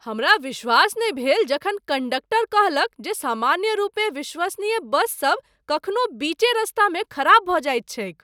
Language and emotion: Maithili, surprised